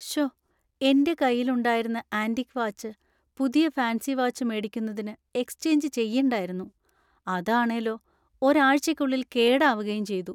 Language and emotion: Malayalam, sad